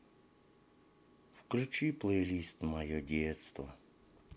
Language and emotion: Russian, sad